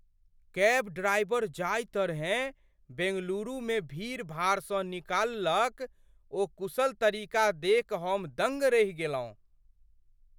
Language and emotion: Maithili, surprised